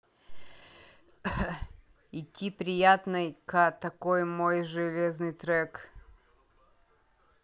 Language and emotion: Russian, neutral